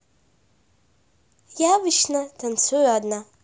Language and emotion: Russian, neutral